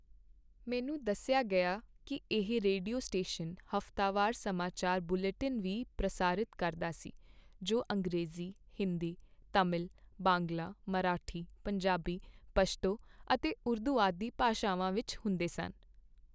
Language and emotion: Punjabi, neutral